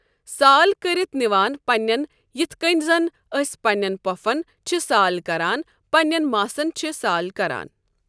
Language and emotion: Kashmiri, neutral